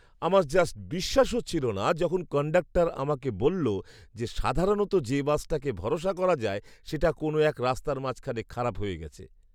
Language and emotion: Bengali, surprised